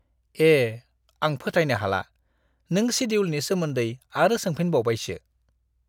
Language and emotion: Bodo, disgusted